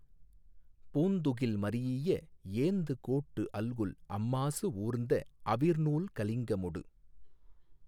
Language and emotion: Tamil, neutral